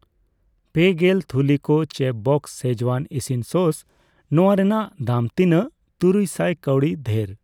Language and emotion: Santali, neutral